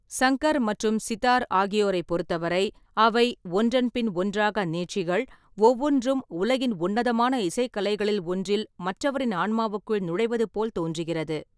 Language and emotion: Tamil, neutral